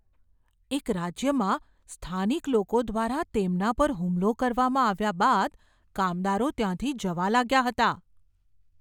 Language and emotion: Gujarati, fearful